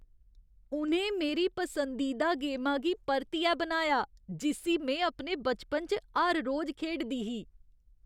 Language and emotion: Dogri, surprised